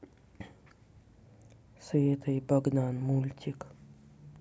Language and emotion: Russian, neutral